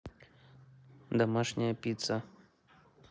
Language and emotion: Russian, neutral